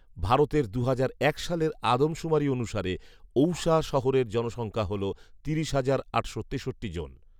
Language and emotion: Bengali, neutral